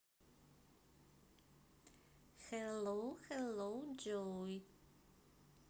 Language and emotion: Russian, neutral